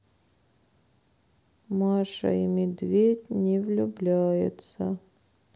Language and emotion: Russian, sad